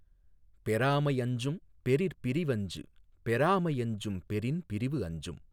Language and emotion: Tamil, neutral